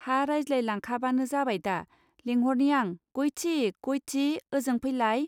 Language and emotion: Bodo, neutral